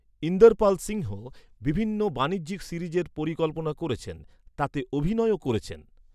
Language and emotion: Bengali, neutral